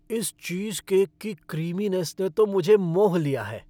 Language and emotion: Hindi, happy